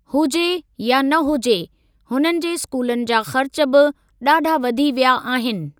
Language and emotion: Sindhi, neutral